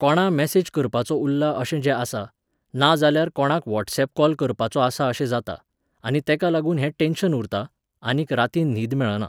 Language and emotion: Goan Konkani, neutral